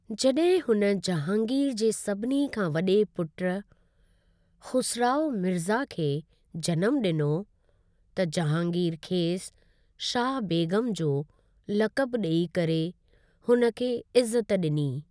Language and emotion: Sindhi, neutral